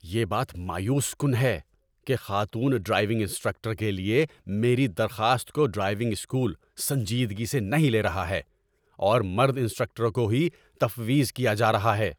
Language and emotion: Urdu, angry